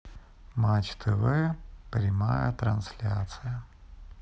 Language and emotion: Russian, sad